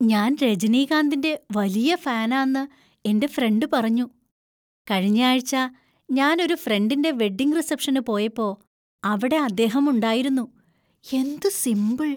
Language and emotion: Malayalam, surprised